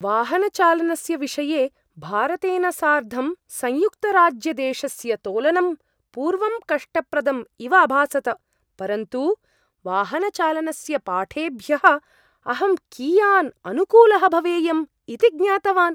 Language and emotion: Sanskrit, surprised